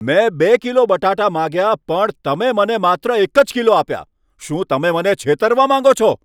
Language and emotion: Gujarati, angry